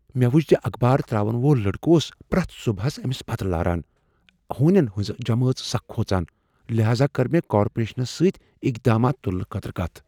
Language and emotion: Kashmiri, fearful